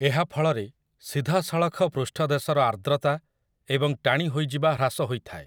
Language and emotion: Odia, neutral